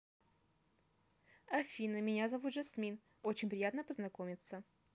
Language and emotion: Russian, positive